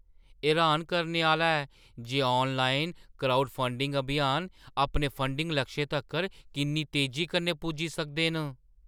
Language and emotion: Dogri, surprised